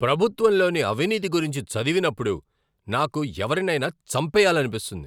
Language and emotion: Telugu, angry